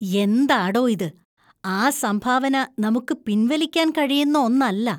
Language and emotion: Malayalam, disgusted